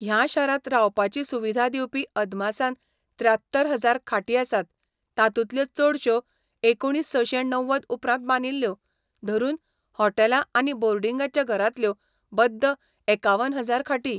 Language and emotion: Goan Konkani, neutral